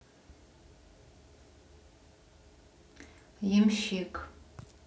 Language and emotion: Russian, neutral